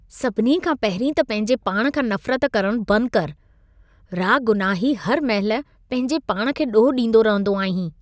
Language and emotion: Sindhi, disgusted